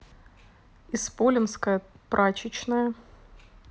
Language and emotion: Russian, neutral